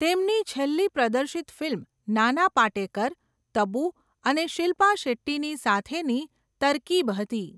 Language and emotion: Gujarati, neutral